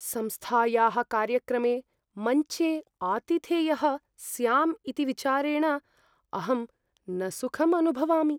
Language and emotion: Sanskrit, fearful